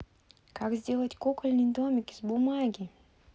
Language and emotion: Russian, positive